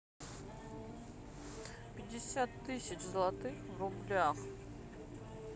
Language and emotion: Russian, neutral